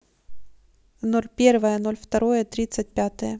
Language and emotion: Russian, neutral